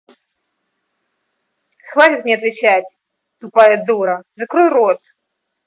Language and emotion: Russian, angry